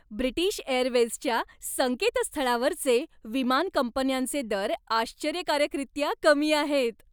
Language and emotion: Marathi, happy